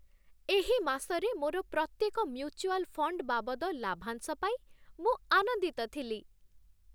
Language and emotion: Odia, happy